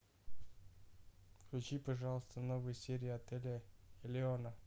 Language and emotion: Russian, neutral